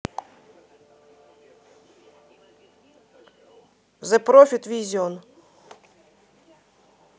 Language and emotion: Russian, positive